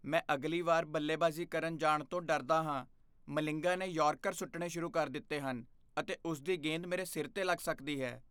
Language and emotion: Punjabi, fearful